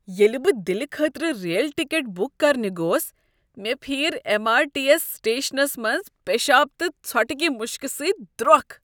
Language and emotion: Kashmiri, disgusted